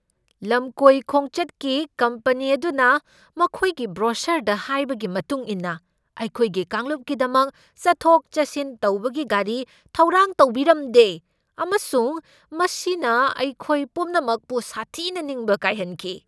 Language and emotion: Manipuri, angry